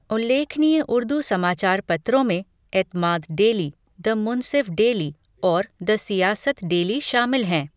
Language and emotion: Hindi, neutral